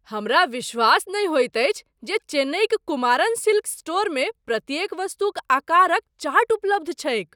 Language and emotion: Maithili, surprised